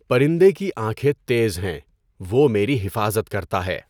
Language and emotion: Urdu, neutral